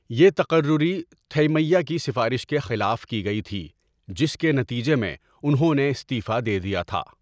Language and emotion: Urdu, neutral